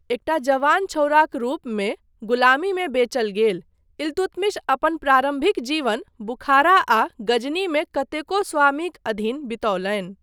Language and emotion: Maithili, neutral